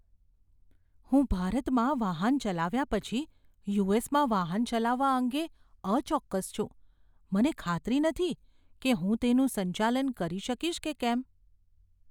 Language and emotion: Gujarati, fearful